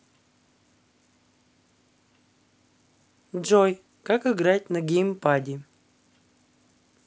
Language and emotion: Russian, neutral